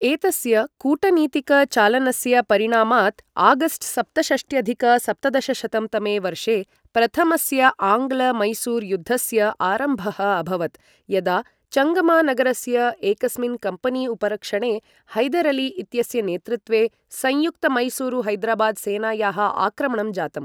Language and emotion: Sanskrit, neutral